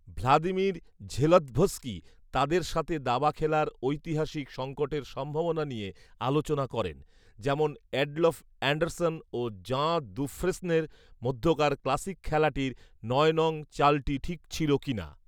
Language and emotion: Bengali, neutral